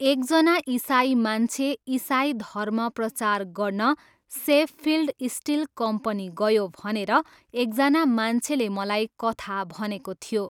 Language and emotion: Nepali, neutral